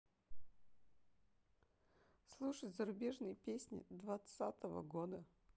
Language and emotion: Russian, sad